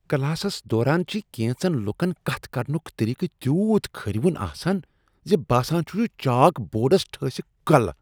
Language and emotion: Kashmiri, disgusted